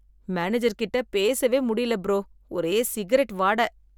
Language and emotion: Tamil, disgusted